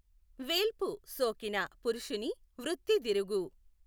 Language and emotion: Telugu, neutral